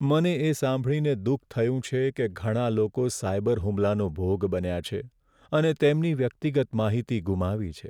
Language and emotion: Gujarati, sad